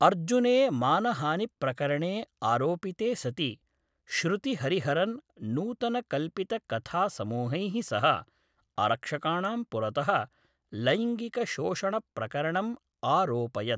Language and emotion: Sanskrit, neutral